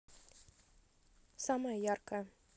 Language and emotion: Russian, positive